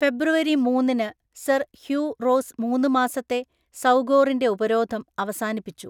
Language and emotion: Malayalam, neutral